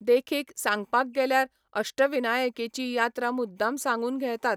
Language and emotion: Goan Konkani, neutral